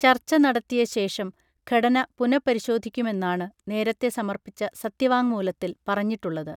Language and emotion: Malayalam, neutral